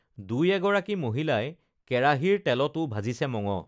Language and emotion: Assamese, neutral